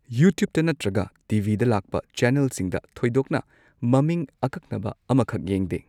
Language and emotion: Manipuri, neutral